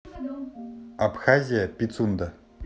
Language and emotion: Russian, neutral